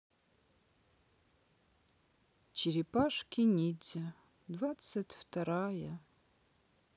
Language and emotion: Russian, sad